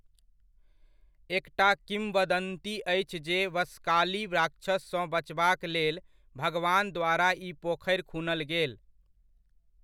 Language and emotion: Maithili, neutral